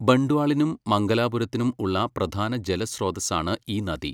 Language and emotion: Malayalam, neutral